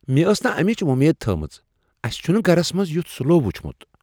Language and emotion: Kashmiri, surprised